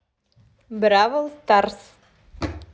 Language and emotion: Russian, positive